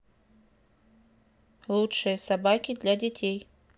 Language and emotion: Russian, neutral